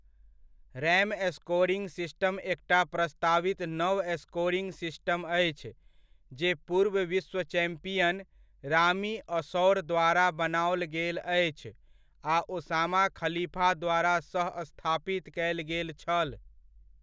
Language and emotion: Maithili, neutral